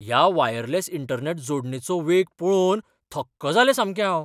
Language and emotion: Goan Konkani, surprised